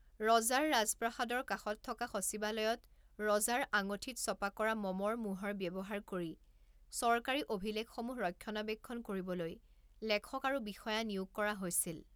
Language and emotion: Assamese, neutral